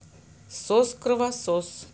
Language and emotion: Russian, neutral